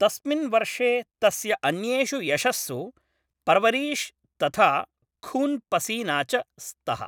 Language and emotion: Sanskrit, neutral